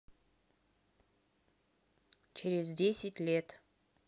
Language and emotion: Russian, neutral